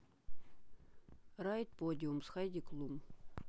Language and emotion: Russian, neutral